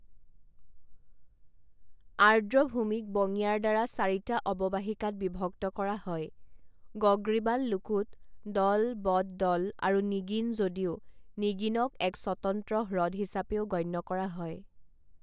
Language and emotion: Assamese, neutral